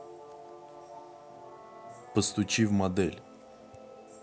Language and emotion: Russian, neutral